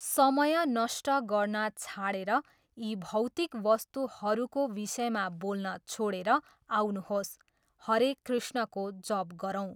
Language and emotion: Nepali, neutral